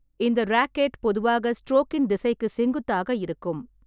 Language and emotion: Tamil, neutral